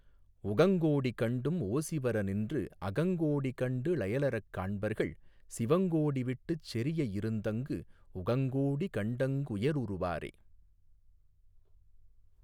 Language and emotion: Tamil, neutral